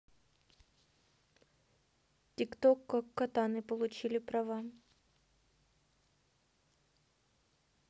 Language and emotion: Russian, neutral